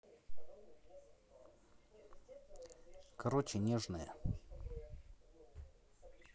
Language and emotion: Russian, neutral